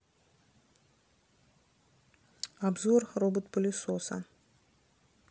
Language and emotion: Russian, neutral